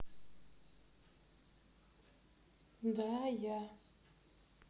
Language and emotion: Russian, neutral